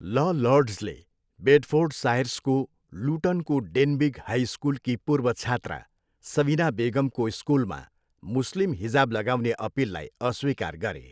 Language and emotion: Nepali, neutral